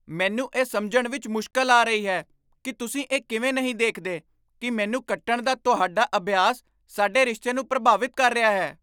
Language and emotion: Punjabi, surprised